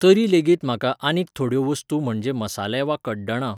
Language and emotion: Goan Konkani, neutral